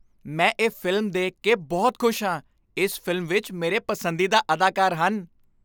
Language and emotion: Punjabi, happy